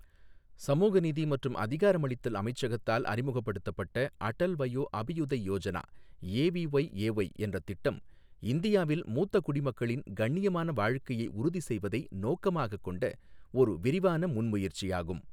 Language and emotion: Tamil, neutral